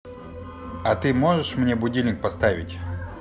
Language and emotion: Russian, neutral